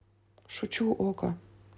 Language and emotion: Russian, neutral